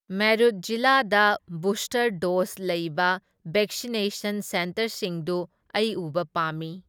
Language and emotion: Manipuri, neutral